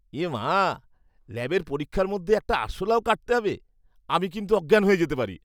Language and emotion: Bengali, disgusted